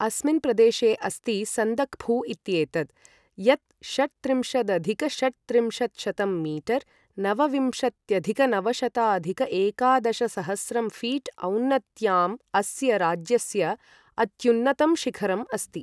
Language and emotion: Sanskrit, neutral